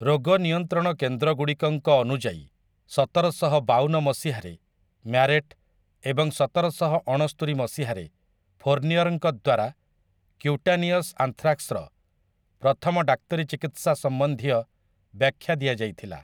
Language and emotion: Odia, neutral